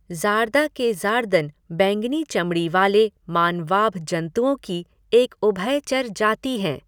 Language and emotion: Hindi, neutral